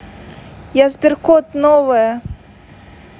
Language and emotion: Russian, neutral